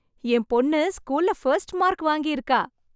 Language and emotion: Tamil, happy